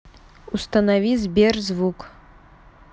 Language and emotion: Russian, neutral